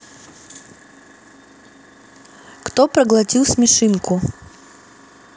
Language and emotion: Russian, neutral